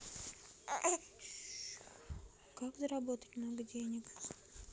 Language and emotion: Russian, neutral